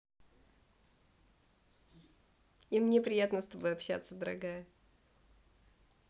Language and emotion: Russian, positive